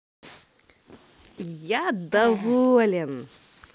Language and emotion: Russian, positive